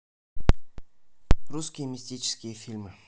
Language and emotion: Russian, neutral